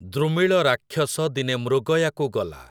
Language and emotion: Odia, neutral